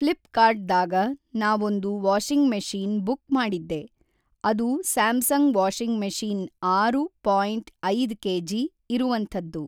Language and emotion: Kannada, neutral